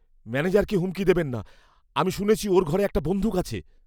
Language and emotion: Bengali, fearful